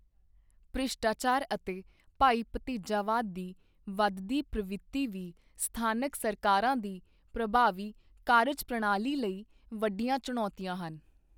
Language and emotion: Punjabi, neutral